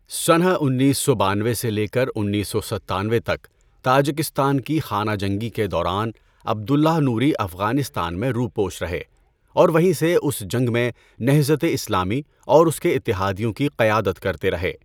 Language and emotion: Urdu, neutral